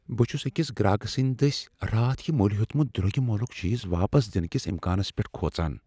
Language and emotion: Kashmiri, fearful